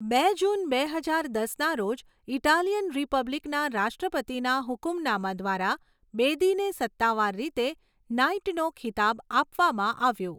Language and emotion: Gujarati, neutral